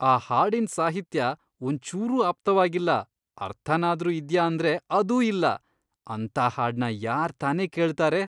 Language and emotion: Kannada, disgusted